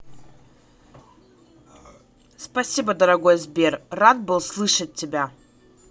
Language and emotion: Russian, positive